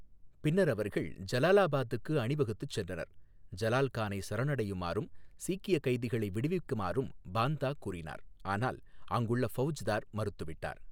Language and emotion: Tamil, neutral